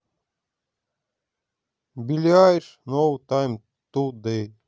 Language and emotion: Russian, neutral